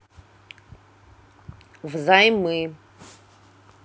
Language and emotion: Russian, neutral